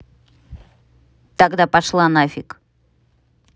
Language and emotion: Russian, angry